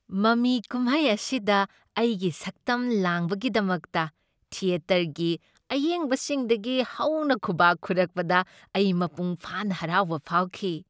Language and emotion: Manipuri, happy